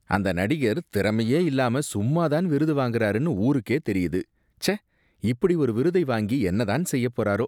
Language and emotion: Tamil, disgusted